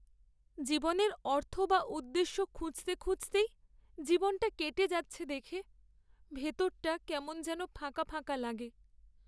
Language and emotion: Bengali, sad